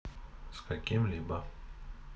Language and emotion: Russian, neutral